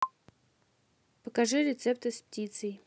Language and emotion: Russian, neutral